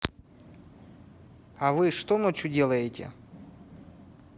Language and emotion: Russian, neutral